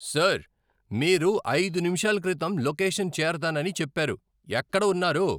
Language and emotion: Telugu, angry